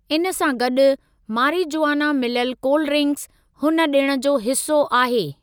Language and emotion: Sindhi, neutral